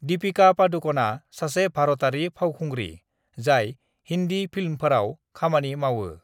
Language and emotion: Bodo, neutral